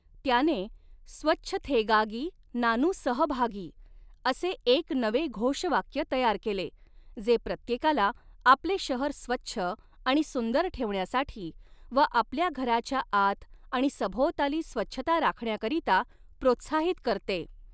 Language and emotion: Marathi, neutral